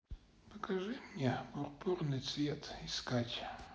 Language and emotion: Russian, sad